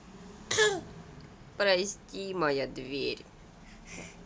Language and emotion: Russian, sad